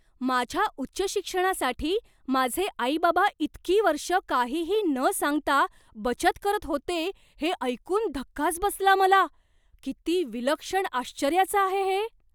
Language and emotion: Marathi, surprised